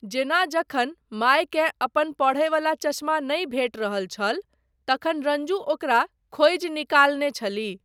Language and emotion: Maithili, neutral